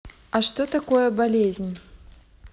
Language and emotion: Russian, neutral